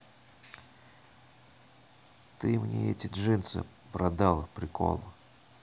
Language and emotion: Russian, neutral